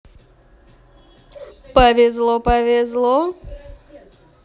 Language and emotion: Russian, positive